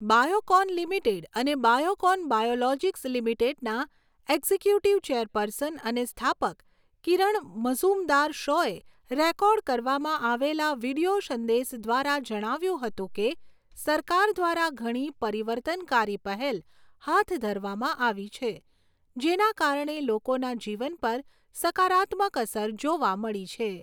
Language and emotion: Gujarati, neutral